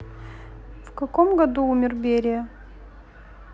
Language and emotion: Russian, neutral